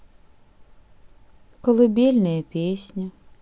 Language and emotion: Russian, sad